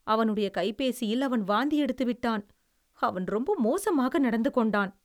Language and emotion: Tamil, disgusted